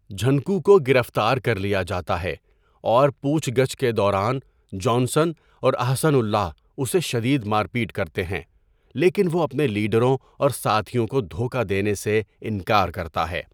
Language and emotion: Urdu, neutral